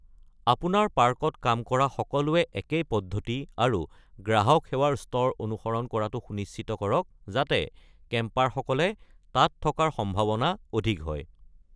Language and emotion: Assamese, neutral